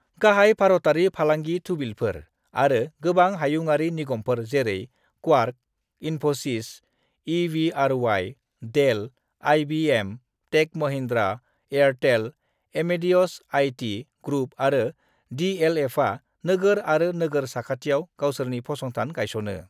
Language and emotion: Bodo, neutral